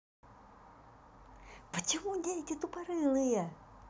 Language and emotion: Russian, angry